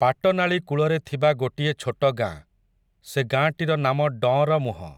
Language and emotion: Odia, neutral